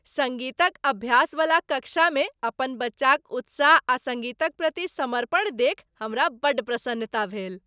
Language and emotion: Maithili, happy